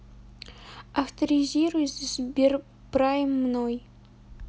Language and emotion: Russian, neutral